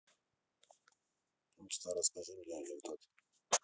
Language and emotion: Russian, neutral